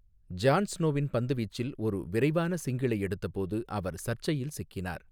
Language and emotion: Tamil, neutral